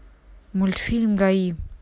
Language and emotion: Russian, neutral